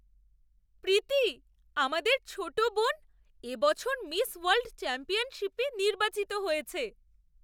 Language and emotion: Bengali, surprised